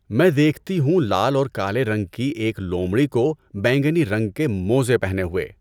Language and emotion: Urdu, neutral